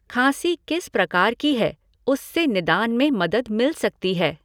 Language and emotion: Hindi, neutral